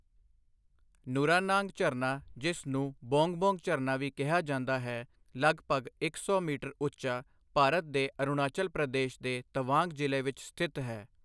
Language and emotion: Punjabi, neutral